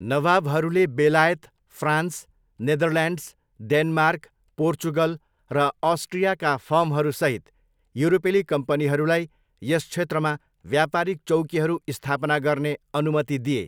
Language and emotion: Nepali, neutral